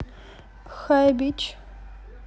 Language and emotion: Russian, neutral